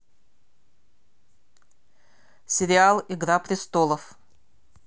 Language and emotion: Russian, neutral